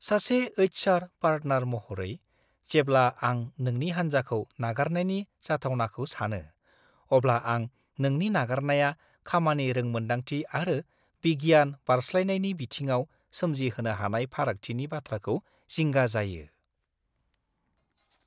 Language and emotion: Bodo, fearful